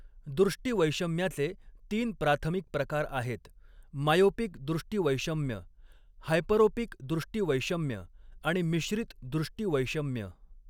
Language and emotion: Marathi, neutral